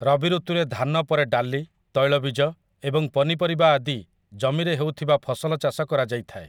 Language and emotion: Odia, neutral